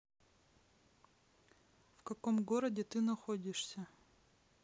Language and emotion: Russian, neutral